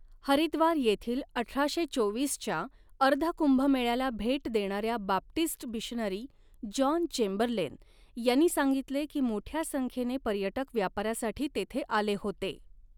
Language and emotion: Marathi, neutral